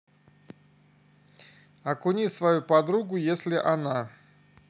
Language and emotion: Russian, neutral